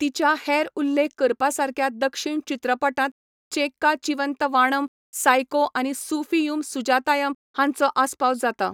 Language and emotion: Goan Konkani, neutral